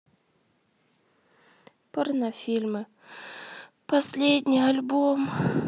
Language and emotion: Russian, sad